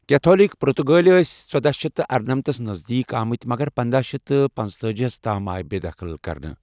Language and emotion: Kashmiri, neutral